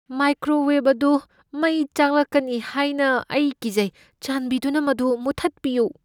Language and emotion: Manipuri, fearful